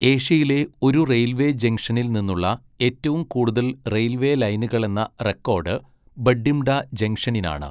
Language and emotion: Malayalam, neutral